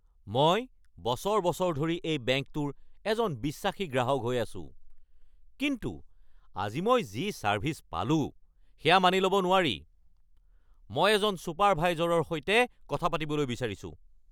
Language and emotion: Assamese, angry